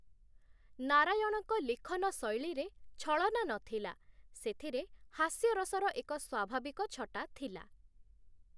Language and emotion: Odia, neutral